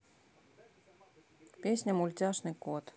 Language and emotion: Russian, neutral